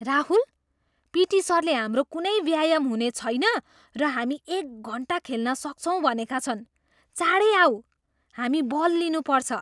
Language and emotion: Nepali, surprised